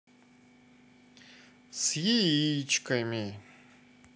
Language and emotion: Russian, sad